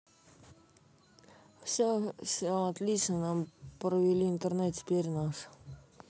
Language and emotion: Russian, neutral